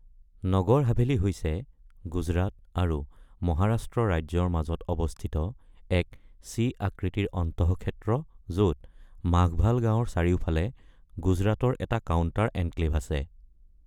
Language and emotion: Assamese, neutral